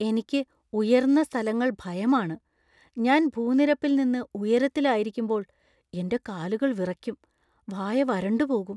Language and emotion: Malayalam, fearful